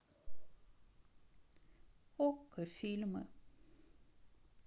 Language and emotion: Russian, sad